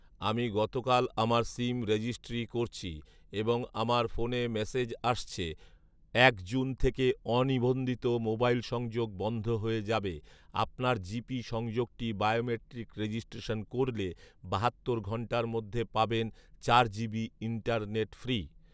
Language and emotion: Bengali, neutral